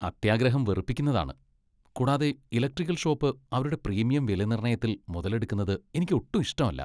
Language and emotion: Malayalam, disgusted